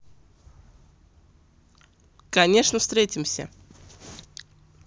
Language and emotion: Russian, positive